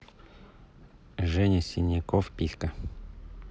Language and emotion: Russian, neutral